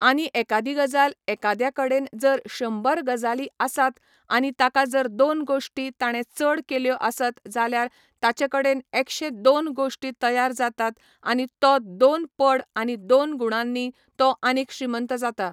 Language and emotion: Goan Konkani, neutral